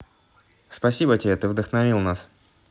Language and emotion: Russian, positive